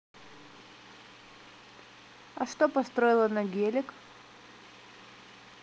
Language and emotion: Russian, neutral